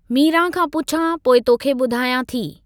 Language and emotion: Sindhi, neutral